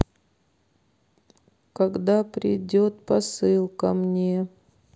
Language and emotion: Russian, sad